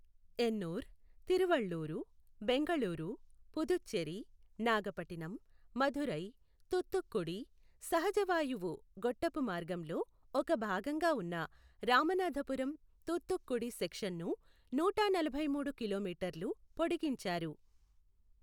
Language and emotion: Telugu, neutral